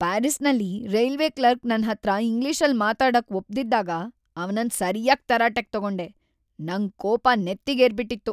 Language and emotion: Kannada, angry